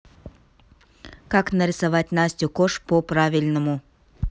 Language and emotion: Russian, neutral